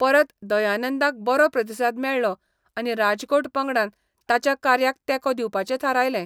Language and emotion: Goan Konkani, neutral